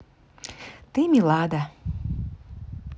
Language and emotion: Russian, positive